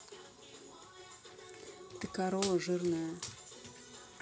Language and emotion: Russian, neutral